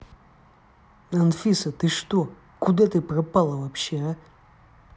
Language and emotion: Russian, angry